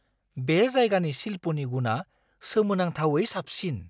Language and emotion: Bodo, surprised